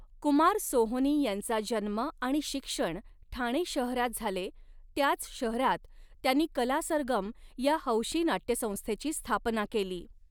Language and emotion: Marathi, neutral